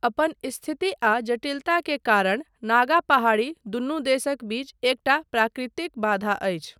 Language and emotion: Maithili, neutral